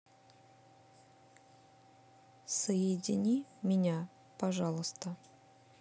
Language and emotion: Russian, neutral